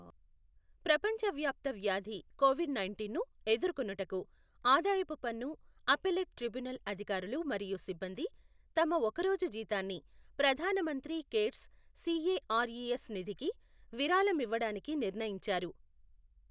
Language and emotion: Telugu, neutral